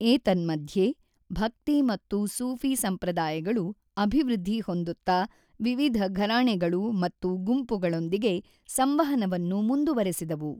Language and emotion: Kannada, neutral